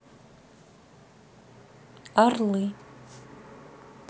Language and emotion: Russian, neutral